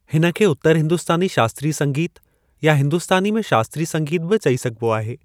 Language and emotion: Sindhi, neutral